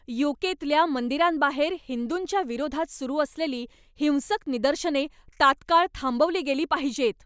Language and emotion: Marathi, angry